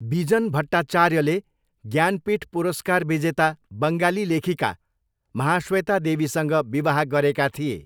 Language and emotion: Nepali, neutral